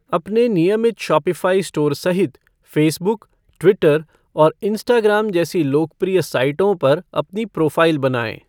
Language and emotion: Hindi, neutral